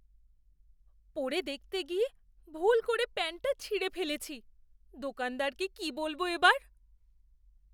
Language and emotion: Bengali, fearful